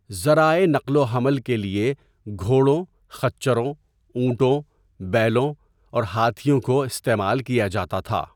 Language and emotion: Urdu, neutral